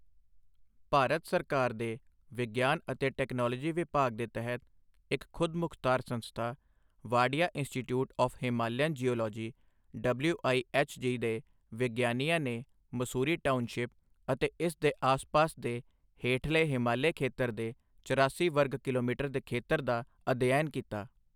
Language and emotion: Punjabi, neutral